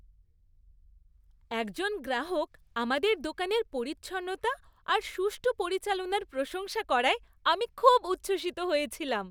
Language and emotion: Bengali, happy